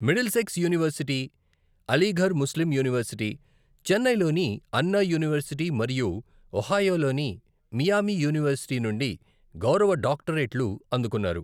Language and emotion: Telugu, neutral